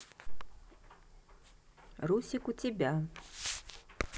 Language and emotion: Russian, neutral